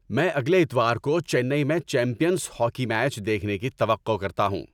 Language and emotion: Urdu, happy